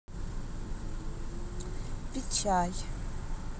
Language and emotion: Russian, neutral